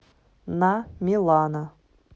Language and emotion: Russian, neutral